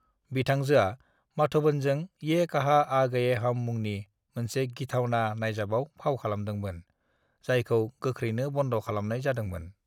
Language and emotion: Bodo, neutral